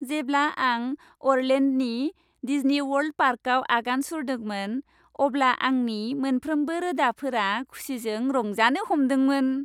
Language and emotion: Bodo, happy